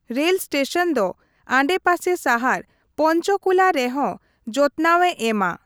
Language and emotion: Santali, neutral